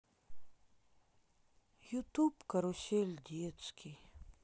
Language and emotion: Russian, sad